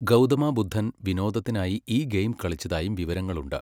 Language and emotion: Malayalam, neutral